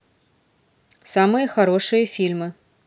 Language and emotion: Russian, neutral